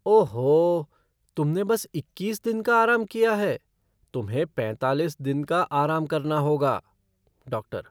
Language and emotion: Hindi, surprised